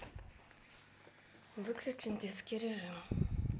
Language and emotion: Russian, neutral